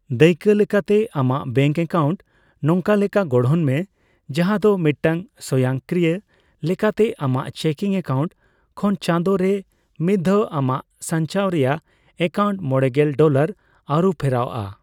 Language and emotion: Santali, neutral